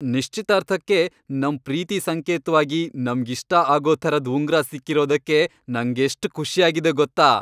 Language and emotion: Kannada, happy